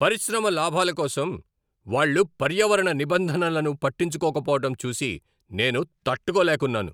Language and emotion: Telugu, angry